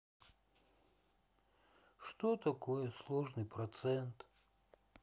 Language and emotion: Russian, sad